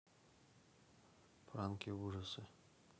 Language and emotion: Russian, neutral